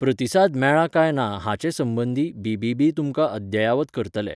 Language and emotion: Goan Konkani, neutral